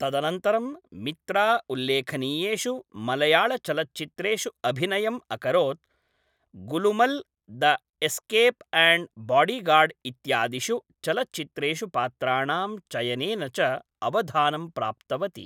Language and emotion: Sanskrit, neutral